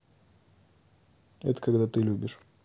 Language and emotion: Russian, neutral